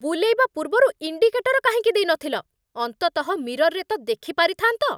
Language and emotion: Odia, angry